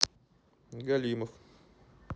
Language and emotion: Russian, neutral